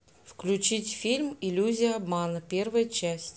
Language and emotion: Russian, neutral